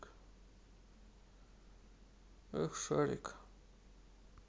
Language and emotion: Russian, sad